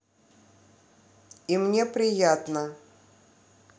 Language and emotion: Russian, neutral